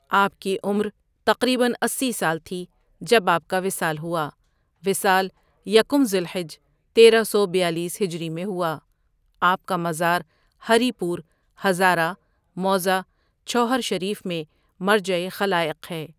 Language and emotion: Urdu, neutral